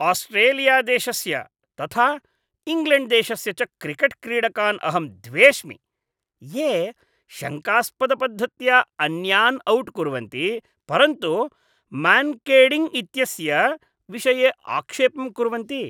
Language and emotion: Sanskrit, disgusted